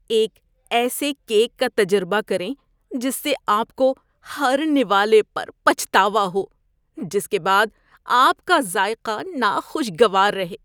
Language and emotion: Urdu, disgusted